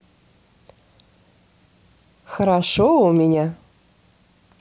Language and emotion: Russian, positive